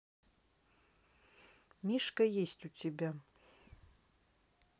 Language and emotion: Russian, neutral